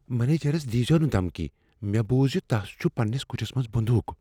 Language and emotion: Kashmiri, fearful